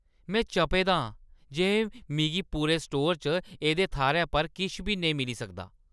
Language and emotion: Dogri, angry